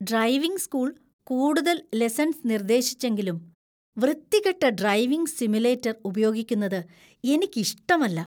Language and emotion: Malayalam, disgusted